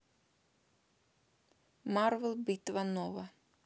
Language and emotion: Russian, neutral